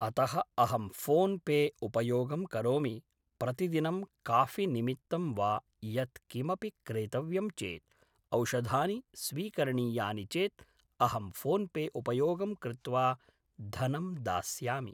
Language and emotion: Sanskrit, neutral